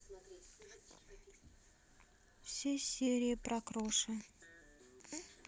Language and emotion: Russian, sad